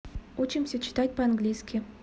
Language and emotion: Russian, neutral